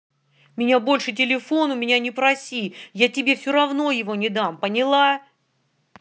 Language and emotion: Russian, angry